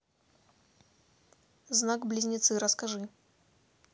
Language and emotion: Russian, neutral